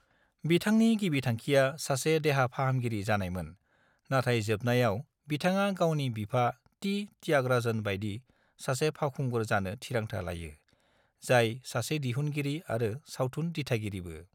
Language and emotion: Bodo, neutral